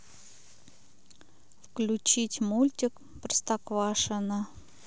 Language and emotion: Russian, neutral